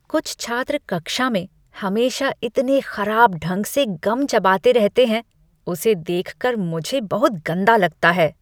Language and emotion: Hindi, disgusted